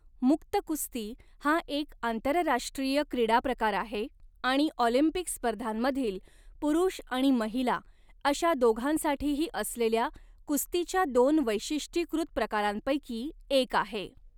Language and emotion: Marathi, neutral